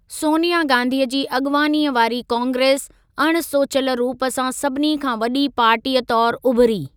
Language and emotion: Sindhi, neutral